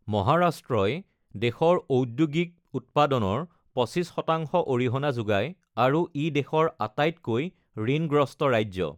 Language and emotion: Assamese, neutral